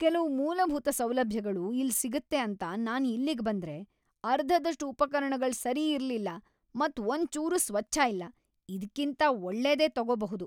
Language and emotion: Kannada, angry